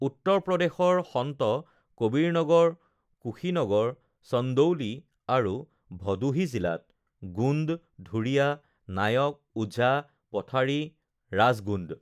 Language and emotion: Assamese, neutral